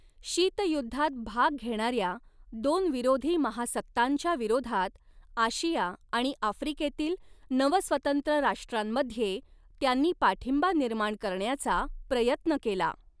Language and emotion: Marathi, neutral